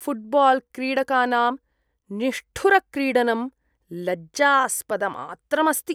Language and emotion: Sanskrit, disgusted